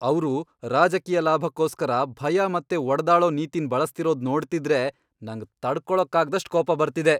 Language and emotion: Kannada, angry